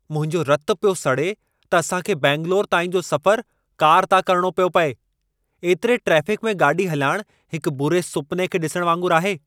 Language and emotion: Sindhi, angry